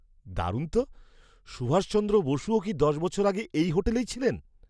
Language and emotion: Bengali, surprised